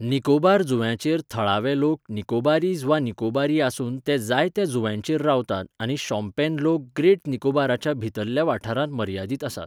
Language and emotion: Goan Konkani, neutral